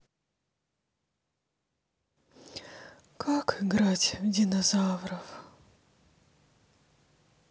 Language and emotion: Russian, sad